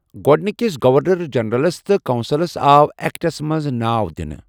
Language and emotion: Kashmiri, neutral